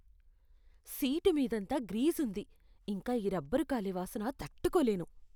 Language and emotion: Telugu, disgusted